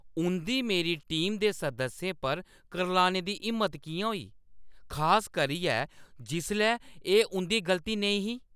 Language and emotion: Dogri, angry